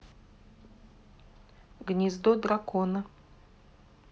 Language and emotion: Russian, neutral